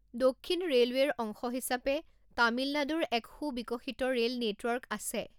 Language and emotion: Assamese, neutral